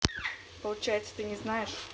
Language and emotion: Russian, neutral